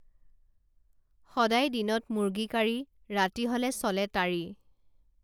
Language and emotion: Assamese, neutral